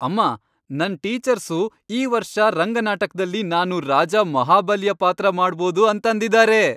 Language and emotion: Kannada, happy